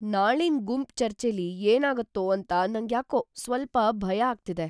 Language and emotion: Kannada, fearful